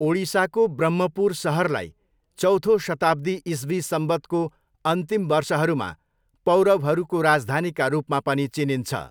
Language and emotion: Nepali, neutral